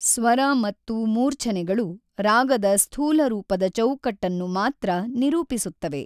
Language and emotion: Kannada, neutral